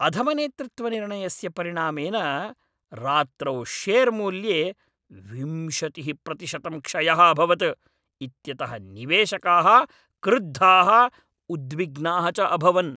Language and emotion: Sanskrit, angry